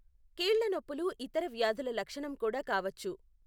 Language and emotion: Telugu, neutral